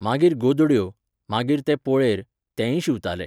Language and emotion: Goan Konkani, neutral